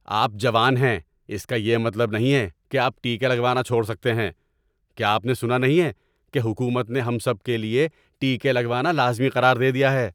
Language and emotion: Urdu, angry